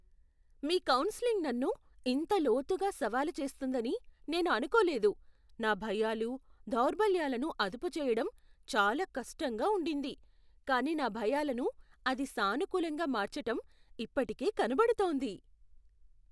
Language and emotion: Telugu, surprised